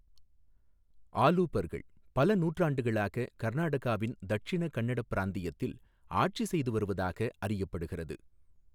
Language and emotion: Tamil, neutral